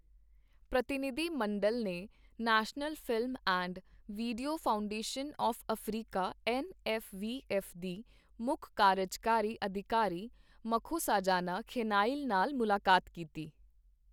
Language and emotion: Punjabi, neutral